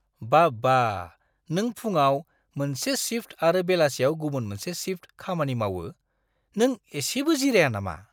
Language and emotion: Bodo, surprised